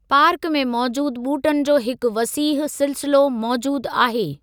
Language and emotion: Sindhi, neutral